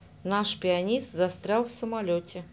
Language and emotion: Russian, neutral